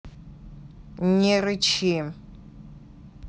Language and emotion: Russian, angry